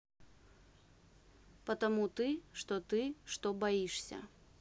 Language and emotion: Russian, neutral